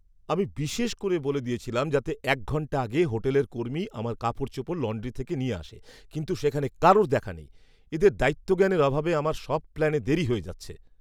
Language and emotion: Bengali, angry